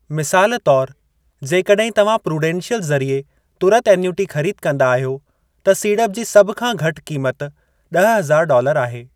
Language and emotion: Sindhi, neutral